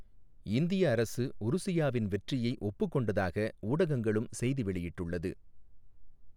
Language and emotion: Tamil, neutral